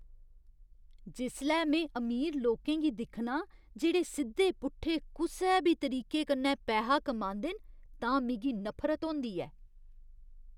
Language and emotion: Dogri, disgusted